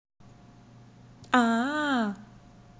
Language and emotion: Russian, positive